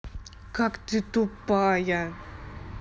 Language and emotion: Russian, angry